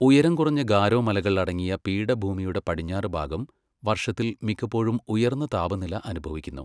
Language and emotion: Malayalam, neutral